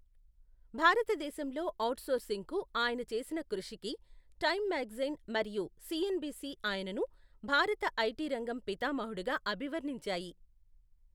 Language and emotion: Telugu, neutral